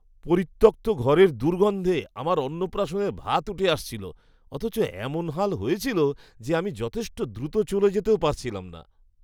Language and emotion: Bengali, disgusted